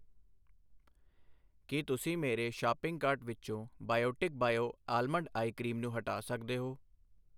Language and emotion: Punjabi, neutral